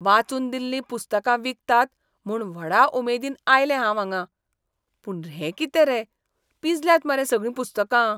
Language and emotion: Goan Konkani, disgusted